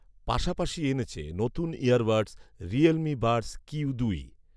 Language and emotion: Bengali, neutral